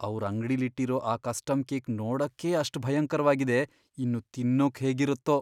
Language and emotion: Kannada, fearful